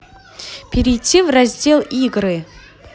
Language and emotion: Russian, angry